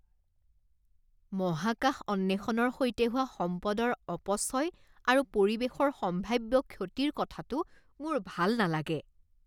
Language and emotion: Assamese, disgusted